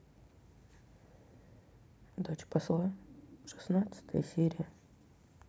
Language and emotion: Russian, sad